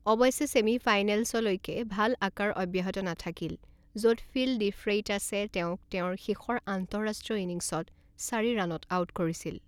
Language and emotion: Assamese, neutral